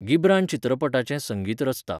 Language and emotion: Goan Konkani, neutral